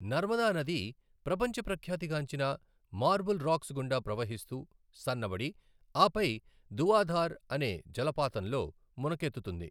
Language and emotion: Telugu, neutral